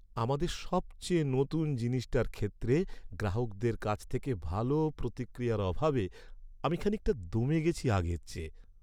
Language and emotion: Bengali, sad